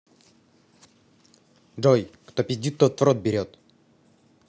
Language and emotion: Russian, neutral